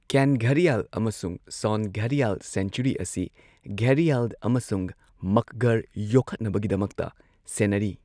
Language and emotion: Manipuri, neutral